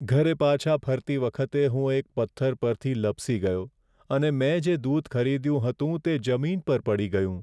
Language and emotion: Gujarati, sad